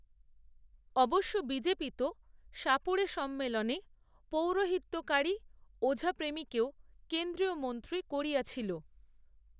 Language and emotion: Bengali, neutral